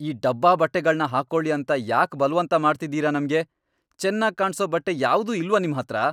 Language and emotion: Kannada, angry